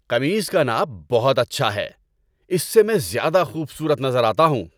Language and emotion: Urdu, happy